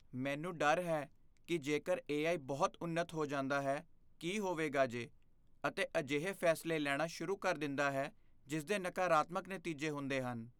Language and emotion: Punjabi, fearful